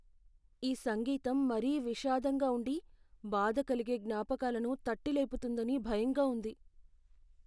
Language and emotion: Telugu, fearful